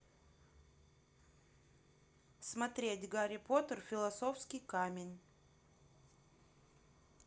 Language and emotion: Russian, neutral